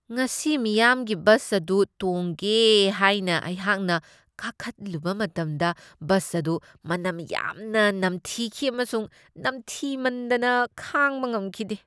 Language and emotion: Manipuri, disgusted